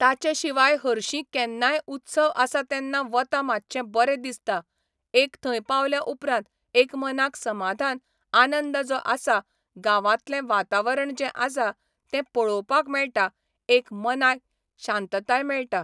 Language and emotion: Goan Konkani, neutral